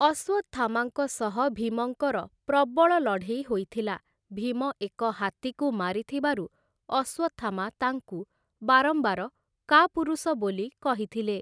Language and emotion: Odia, neutral